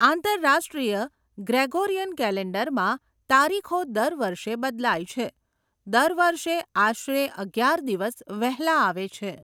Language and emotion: Gujarati, neutral